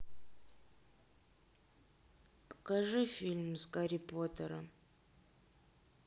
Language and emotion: Russian, sad